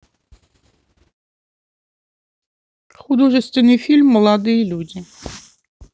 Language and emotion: Russian, neutral